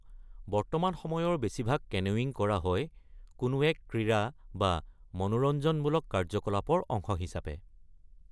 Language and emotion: Assamese, neutral